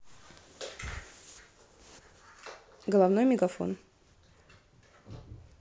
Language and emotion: Russian, neutral